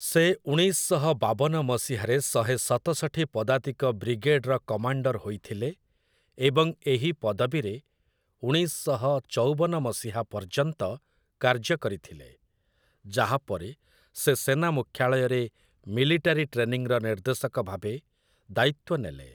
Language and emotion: Odia, neutral